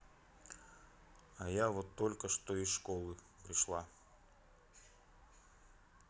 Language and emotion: Russian, neutral